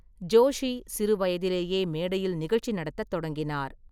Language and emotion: Tamil, neutral